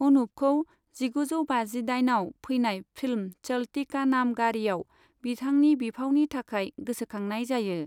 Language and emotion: Bodo, neutral